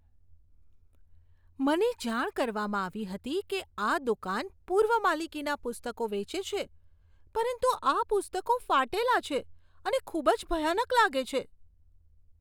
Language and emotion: Gujarati, disgusted